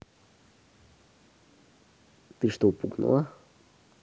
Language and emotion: Russian, neutral